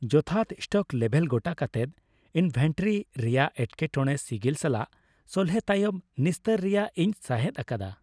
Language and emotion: Santali, happy